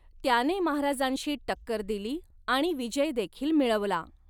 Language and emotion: Marathi, neutral